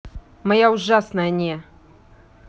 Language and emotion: Russian, neutral